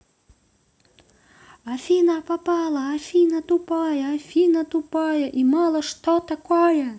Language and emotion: Russian, positive